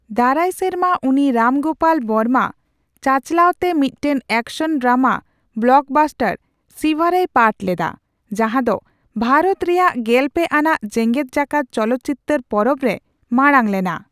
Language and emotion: Santali, neutral